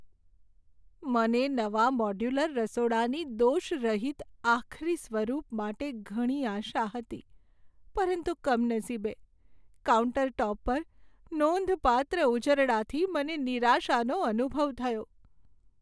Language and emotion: Gujarati, sad